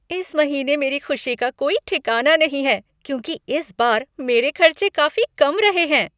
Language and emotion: Hindi, happy